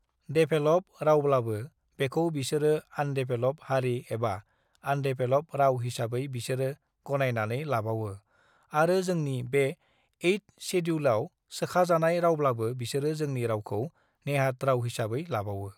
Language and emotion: Bodo, neutral